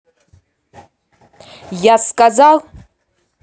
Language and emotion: Russian, angry